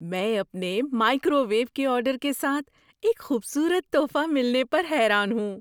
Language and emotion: Urdu, surprised